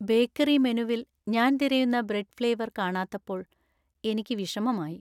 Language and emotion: Malayalam, sad